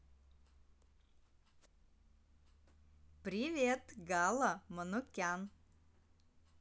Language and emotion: Russian, positive